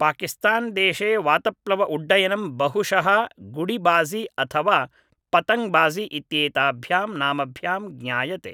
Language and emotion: Sanskrit, neutral